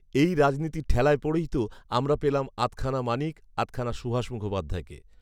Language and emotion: Bengali, neutral